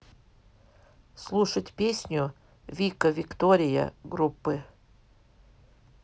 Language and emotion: Russian, neutral